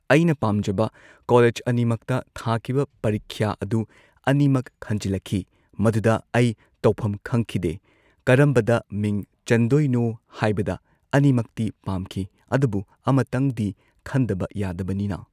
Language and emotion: Manipuri, neutral